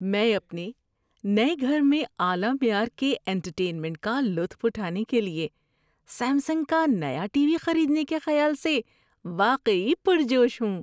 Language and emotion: Urdu, happy